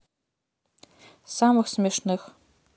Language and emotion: Russian, neutral